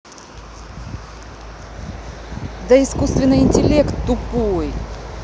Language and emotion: Russian, angry